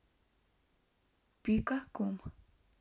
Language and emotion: Russian, neutral